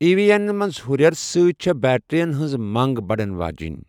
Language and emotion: Kashmiri, neutral